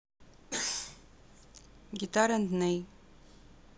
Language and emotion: Russian, neutral